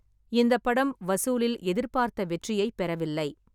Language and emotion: Tamil, neutral